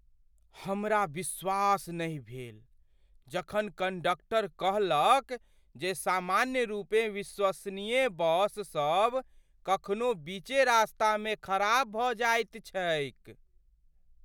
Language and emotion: Maithili, surprised